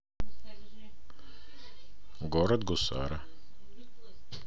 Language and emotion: Russian, neutral